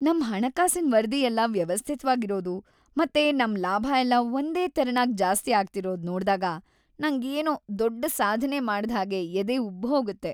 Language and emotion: Kannada, happy